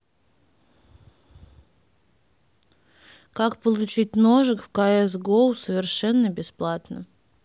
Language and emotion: Russian, neutral